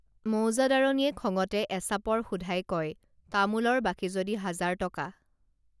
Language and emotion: Assamese, neutral